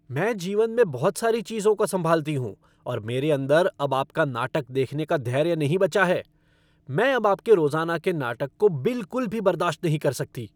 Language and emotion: Hindi, angry